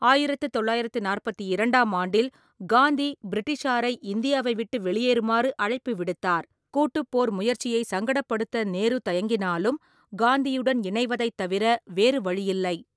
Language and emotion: Tamil, neutral